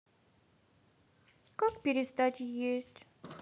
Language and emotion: Russian, sad